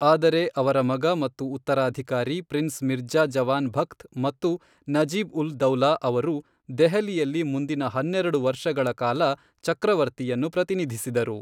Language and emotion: Kannada, neutral